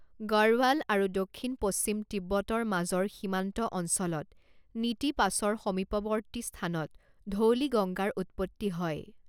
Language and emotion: Assamese, neutral